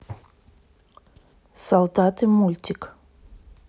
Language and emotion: Russian, neutral